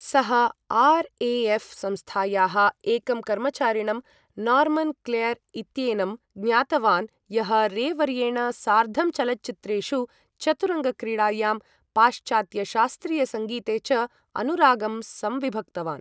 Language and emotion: Sanskrit, neutral